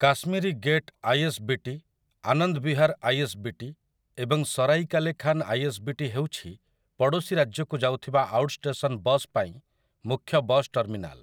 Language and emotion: Odia, neutral